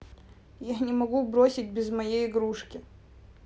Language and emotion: Russian, sad